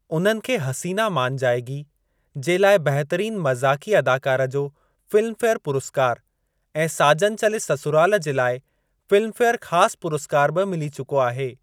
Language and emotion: Sindhi, neutral